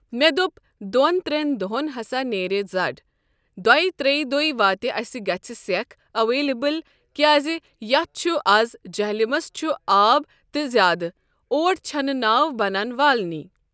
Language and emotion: Kashmiri, neutral